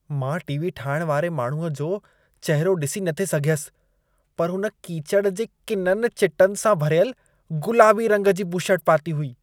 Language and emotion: Sindhi, disgusted